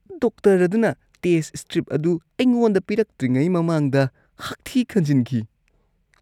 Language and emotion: Manipuri, disgusted